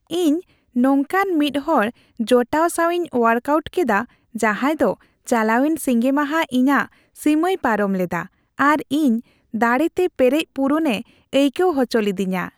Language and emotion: Santali, happy